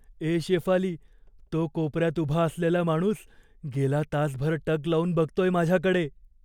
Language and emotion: Marathi, fearful